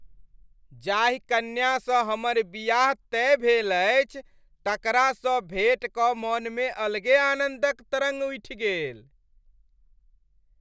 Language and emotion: Maithili, happy